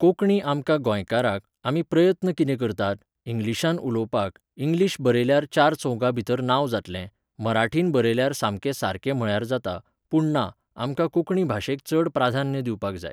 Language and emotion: Goan Konkani, neutral